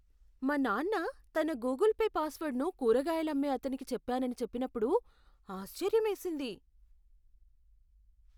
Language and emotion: Telugu, surprised